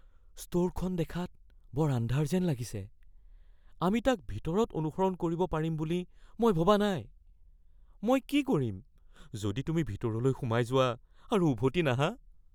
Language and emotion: Assamese, fearful